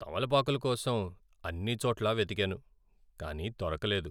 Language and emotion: Telugu, sad